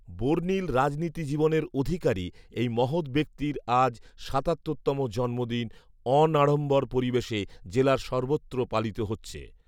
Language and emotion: Bengali, neutral